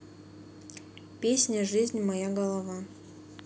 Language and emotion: Russian, neutral